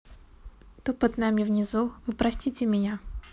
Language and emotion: Russian, neutral